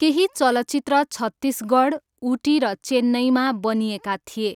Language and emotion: Nepali, neutral